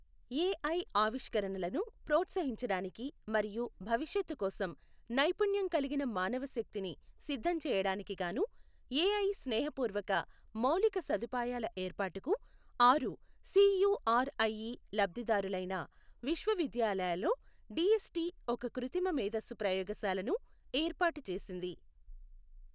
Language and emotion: Telugu, neutral